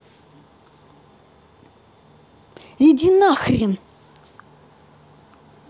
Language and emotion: Russian, angry